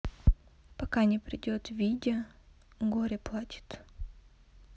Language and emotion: Russian, sad